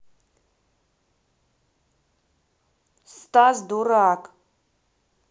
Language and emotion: Russian, neutral